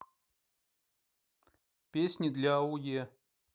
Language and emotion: Russian, neutral